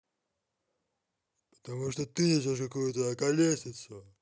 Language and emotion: Russian, angry